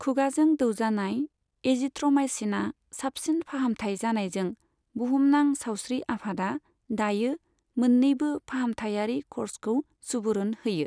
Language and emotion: Bodo, neutral